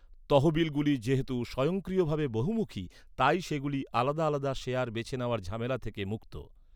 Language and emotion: Bengali, neutral